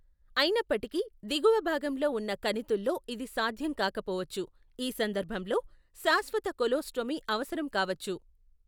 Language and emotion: Telugu, neutral